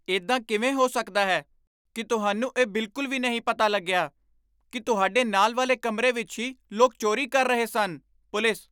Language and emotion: Punjabi, surprised